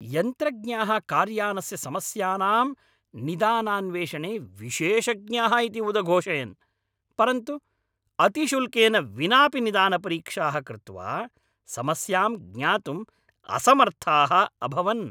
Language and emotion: Sanskrit, angry